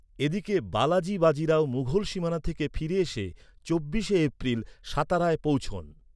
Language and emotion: Bengali, neutral